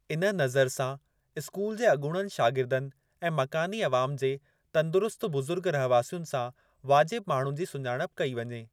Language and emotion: Sindhi, neutral